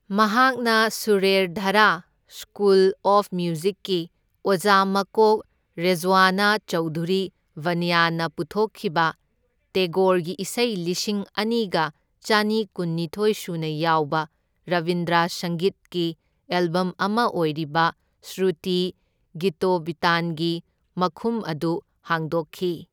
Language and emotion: Manipuri, neutral